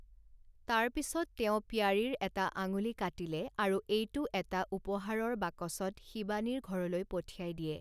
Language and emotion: Assamese, neutral